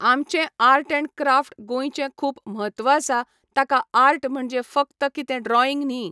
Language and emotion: Goan Konkani, neutral